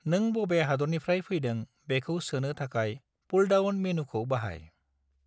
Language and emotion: Bodo, neutral